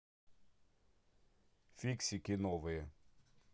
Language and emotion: Russian, neutral